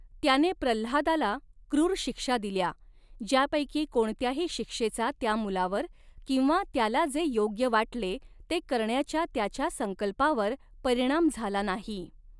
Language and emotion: Marathi, neutral